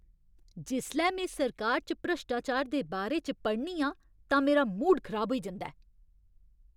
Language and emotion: Dogri, angry